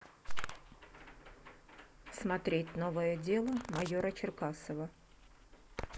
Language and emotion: Russian, neutral